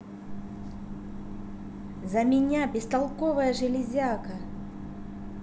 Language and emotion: Russian, angry